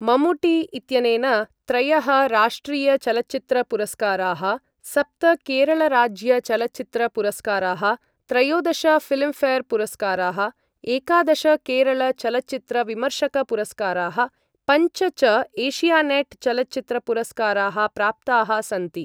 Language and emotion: Sanskrit, neutral